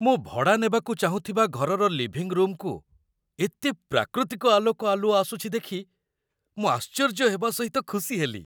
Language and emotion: Odia, surprised